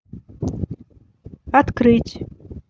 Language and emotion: Russian, neutral